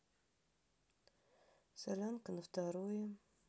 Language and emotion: Russian, neutral